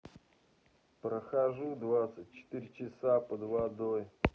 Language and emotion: Russian, neutral